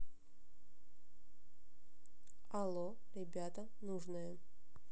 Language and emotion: Russian, neutral